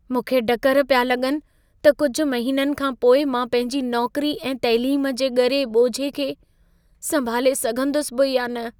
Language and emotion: Sindhi, fearful